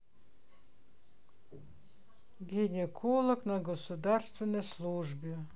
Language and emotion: Russian, sad